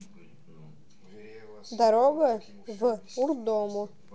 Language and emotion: Russian, neutral